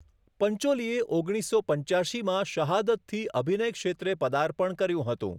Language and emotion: Gujarati, neutral